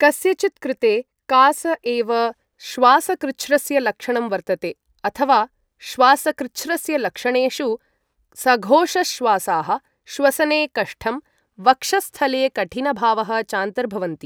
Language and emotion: Sanskrit, neutral